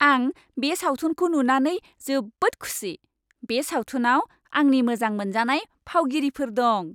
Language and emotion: Bodo, happy